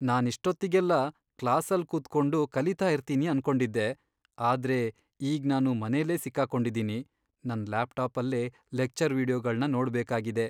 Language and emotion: Kannada, sad